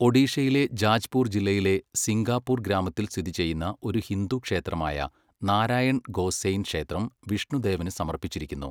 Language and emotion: Malayalam, neutral